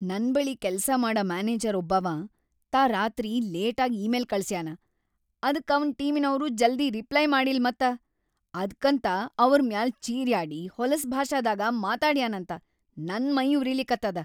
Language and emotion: Kannada, angry